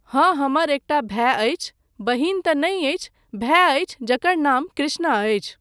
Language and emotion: Maithili, neutral